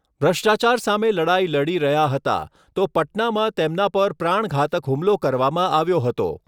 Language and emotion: Gujarati, neutral